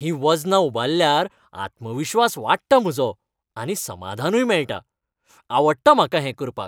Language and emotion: Goan Konkani, happy